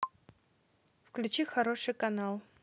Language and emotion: Russian, neutral